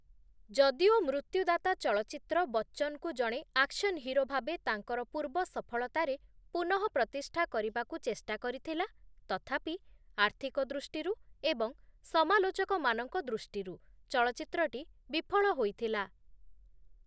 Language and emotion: Odia, neutral